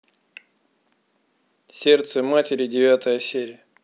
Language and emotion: Russian, neutral